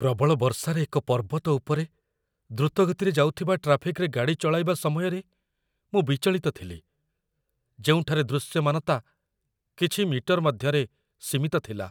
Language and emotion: Odia, fearful